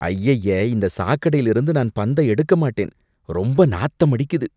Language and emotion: Tamil, disgusted